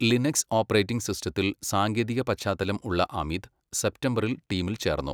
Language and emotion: Malayalam, neutral